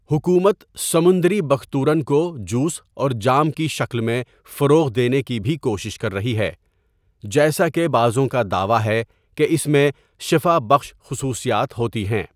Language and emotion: Urdu, neutral